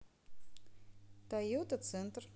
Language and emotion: Russian, neutral